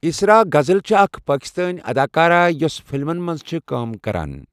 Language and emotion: Kashmiri, neutral